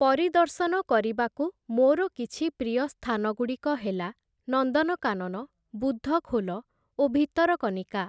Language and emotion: Odia, neutral